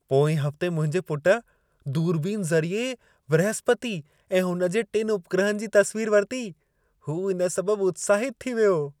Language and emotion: Sindhi, happy